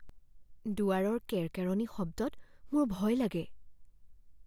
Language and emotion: Assamese, fearful